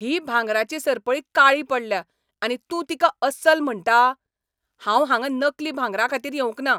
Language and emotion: Goan Konkani, angry